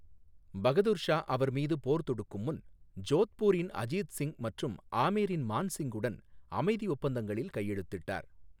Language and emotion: Tamil, neutral